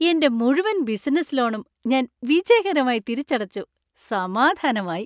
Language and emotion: Malayalam, happy